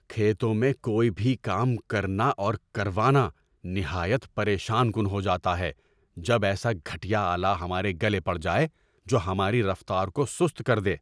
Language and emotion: Urdu, angry